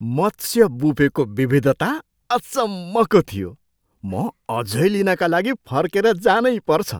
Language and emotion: Nepali, surprised